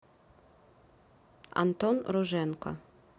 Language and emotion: Russian, neutral